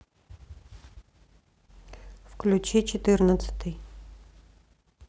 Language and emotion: Russian, neutral